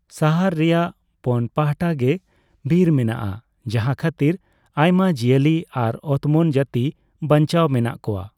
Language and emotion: Santali, neutral